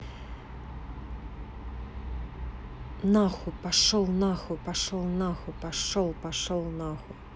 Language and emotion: Russian, angry